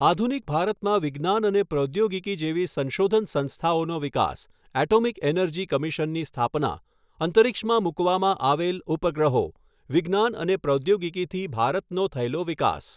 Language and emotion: Gujarati, neutral